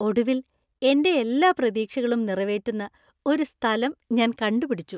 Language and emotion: Malayalam, happy